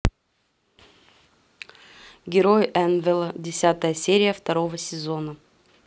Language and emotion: Russian, neutral